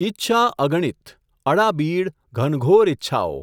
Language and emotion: Gujarati, neutral